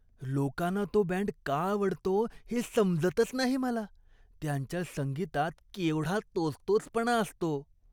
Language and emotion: Marathi, disgusted